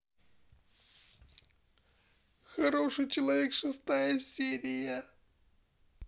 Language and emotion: Russian, sad